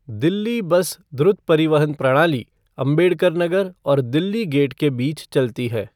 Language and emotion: Hindi, neutral